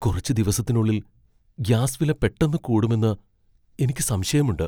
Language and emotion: Malayalam, fearful